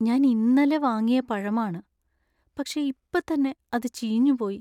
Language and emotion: Malayalam, sad